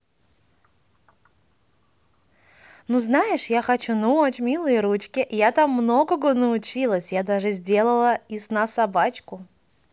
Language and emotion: Russian, positive